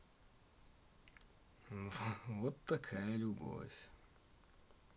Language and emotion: Russian, neutral